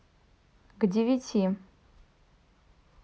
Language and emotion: Russian, neutral